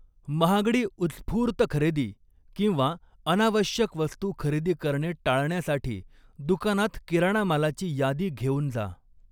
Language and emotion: Marathi, neutral